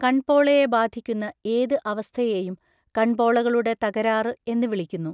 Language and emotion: Malayalam, neutral